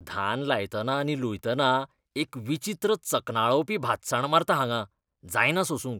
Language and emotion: Goan Konkani, disgusted